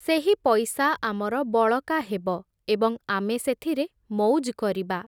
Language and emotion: Odia, neutral